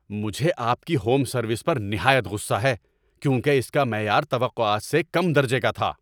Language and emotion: Urdu, angry